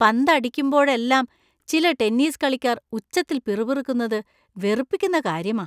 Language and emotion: Malayalam, disgusted